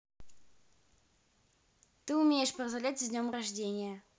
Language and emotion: Russian, neutral